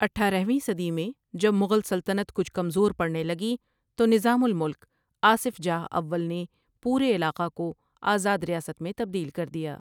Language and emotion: Urdu, neutral